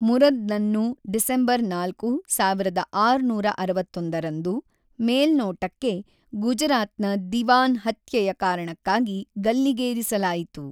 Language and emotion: Kannada, neutral